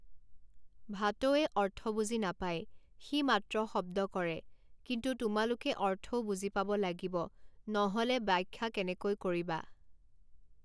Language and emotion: Assamese, neutral